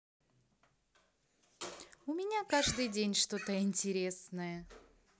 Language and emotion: Russian, positive